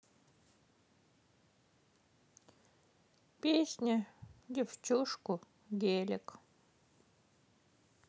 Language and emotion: Russian, sad